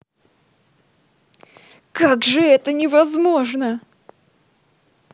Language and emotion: Russian, angry